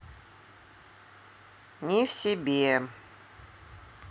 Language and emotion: Russian, neutral